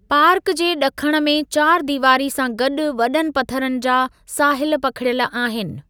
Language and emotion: Sindhi, neutral